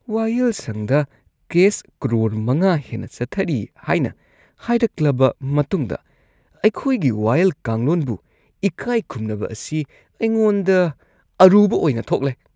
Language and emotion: Manipuri, disgusted